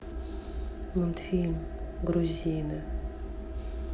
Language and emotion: Russian, sad